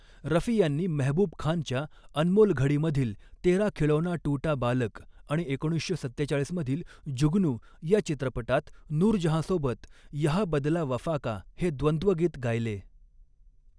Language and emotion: Marathi, neutral